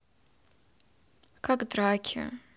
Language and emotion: Russian, neutral